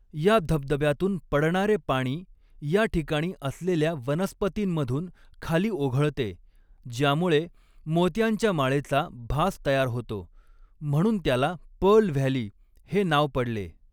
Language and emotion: Marathi, neutral